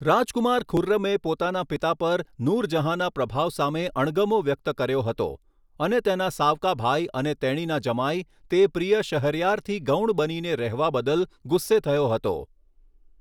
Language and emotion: Gujarati, neutral